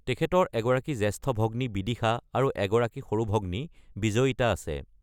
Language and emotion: Assamese, neutral